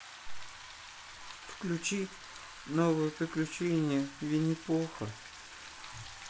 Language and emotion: Russian, sad